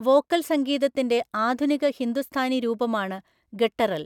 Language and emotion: Malayalam, neutral